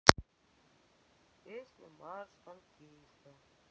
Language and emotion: Russian, sad